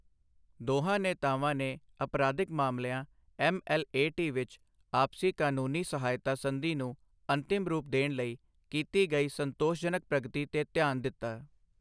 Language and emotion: Punjabi, neutral